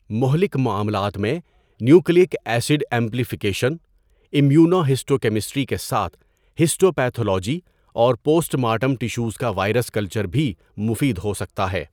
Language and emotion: Urdu, neutral